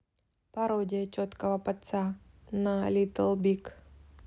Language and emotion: Russian, neutral